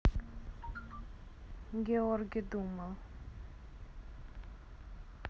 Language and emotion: Russian, neutral